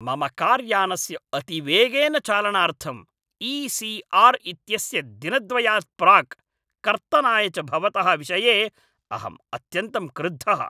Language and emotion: Sanskrit, angry